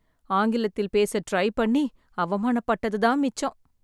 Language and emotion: Tamil, sad